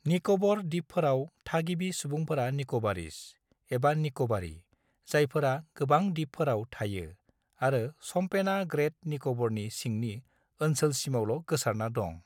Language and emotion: Bodo, neutral